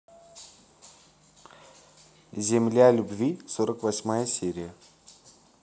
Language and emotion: Russian, neutral